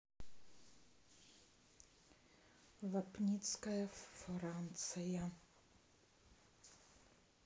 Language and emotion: Russian, neutral